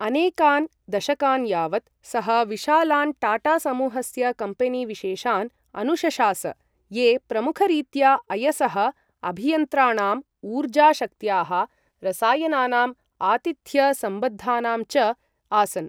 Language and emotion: Sanskrit, neutral